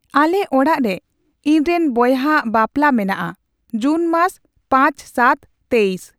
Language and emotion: Santali, neutral